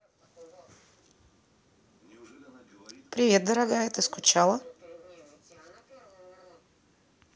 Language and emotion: Russian, neutral